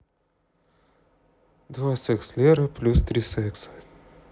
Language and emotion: Russian, neutral